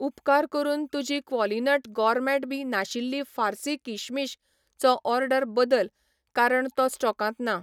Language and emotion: Goan Konkani, neutral